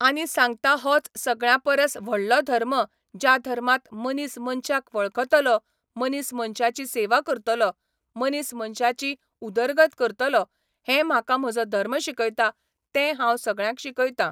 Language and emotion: Goan Konkani, neutral